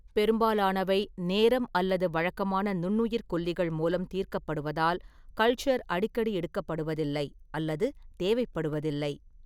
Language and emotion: Tamil, neutral